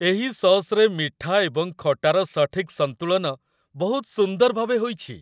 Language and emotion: Odia, happy